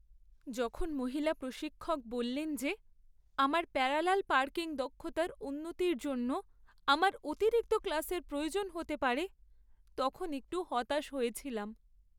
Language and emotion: Bengali, sad